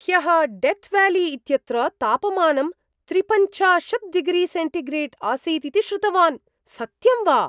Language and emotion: Sanskrit, surprised